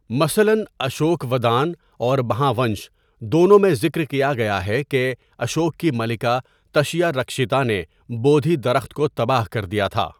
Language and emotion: Urdu, neutral